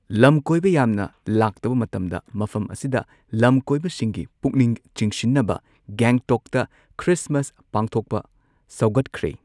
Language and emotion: Manipuri, neutral